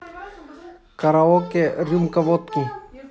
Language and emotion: Russian, neutral